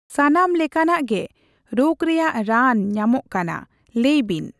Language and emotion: Santali, neutral